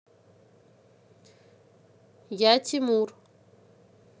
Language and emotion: Russian, neutral